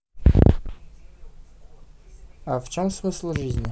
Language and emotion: Russian, neutral